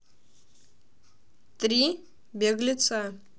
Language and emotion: Russian, neutral